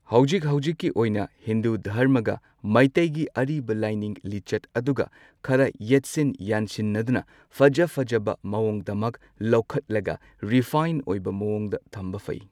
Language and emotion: Manipuri, neutral